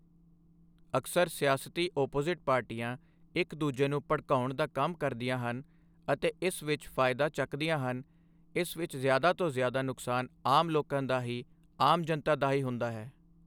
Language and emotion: Punjabi, neutral